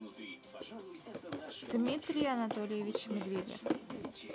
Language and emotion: Russian, neutral